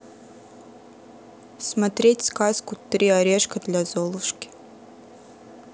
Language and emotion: Russian, neutral